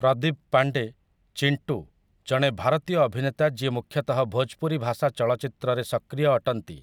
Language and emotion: Odia, neutral